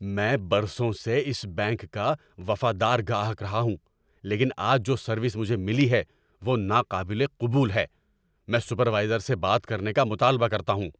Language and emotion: Urdu, angry